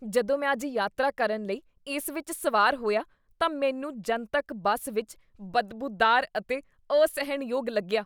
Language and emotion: Punjabi, disgusted